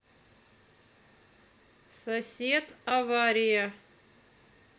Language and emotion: Russian, neutral